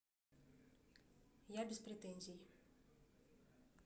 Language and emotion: Russian, neutral